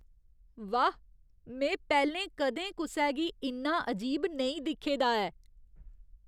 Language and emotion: Dogri, surprised